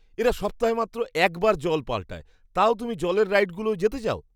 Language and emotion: Bengali, disgusted